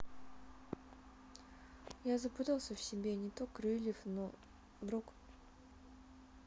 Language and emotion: Russian, sad